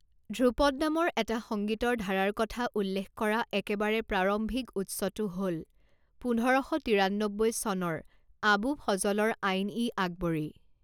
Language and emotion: Assamese, neutral